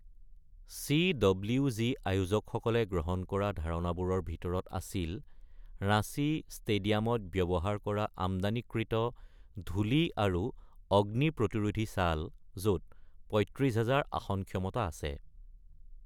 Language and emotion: Assamese, neutral